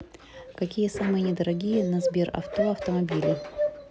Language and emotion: Russian, neutral